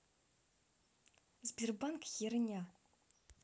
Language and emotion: Russian, angry